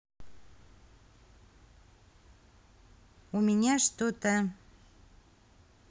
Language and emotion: Russian, neutral